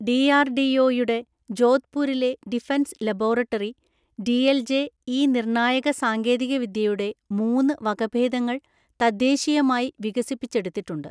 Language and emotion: Malayalam, neutral